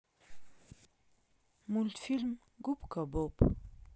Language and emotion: Russian, neutral